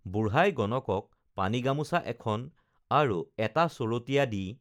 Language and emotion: Assamese, neutral